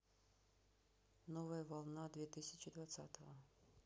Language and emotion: Russian, neutral